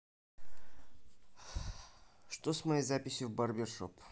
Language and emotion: Russian, neutral